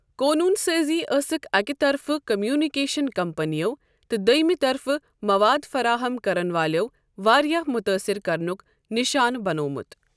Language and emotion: Kashmiri, neutral